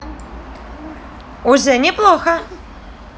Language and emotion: Russian, positive